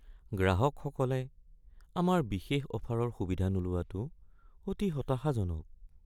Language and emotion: Assamese, sad